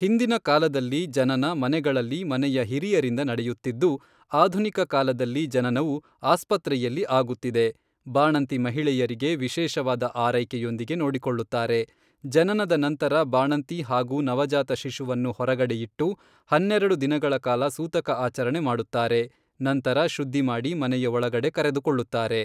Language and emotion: Kannada, neutral